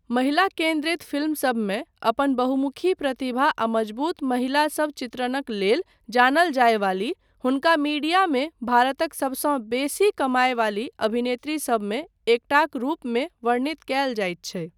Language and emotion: Maithili, neutral